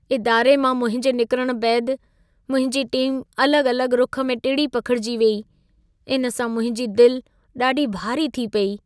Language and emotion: Sindhi, sad